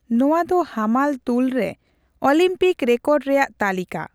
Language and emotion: Santali, neutral